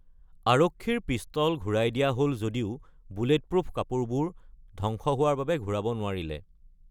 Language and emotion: Assamese, neutral